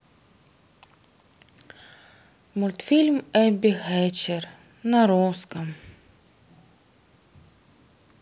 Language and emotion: Russian, sad